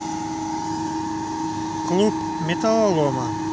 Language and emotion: Russian, neutral